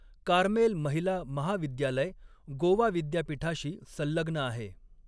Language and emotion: Marathi, neutral